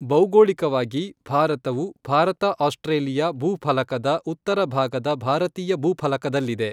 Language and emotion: Kannada, neutral